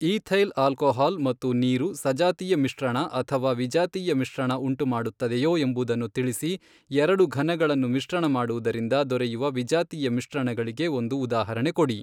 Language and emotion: Kannada, neutral